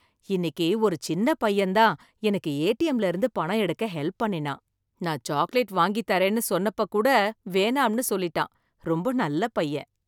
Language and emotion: Tamil, happy